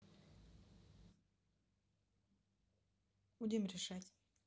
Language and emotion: Russian, neutral